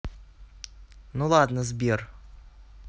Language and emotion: Russian, neutral